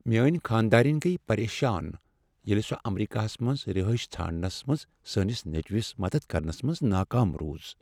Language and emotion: Kashmiri, sad